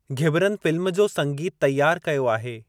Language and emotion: Sindhi, neutral